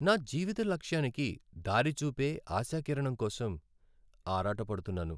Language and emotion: Telugu, sad